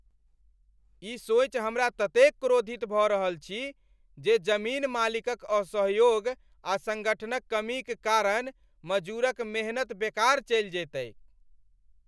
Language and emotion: Maithili, angry